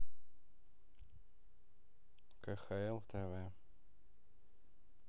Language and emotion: Russian, neutral